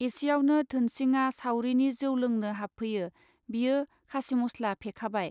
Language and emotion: Bodo, neutral